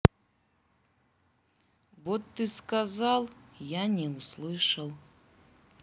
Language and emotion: Russian, neutral